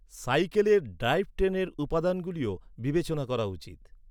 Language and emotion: Bengali, neutral